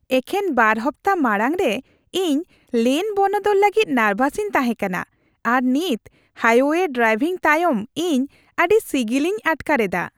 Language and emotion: Santali, happy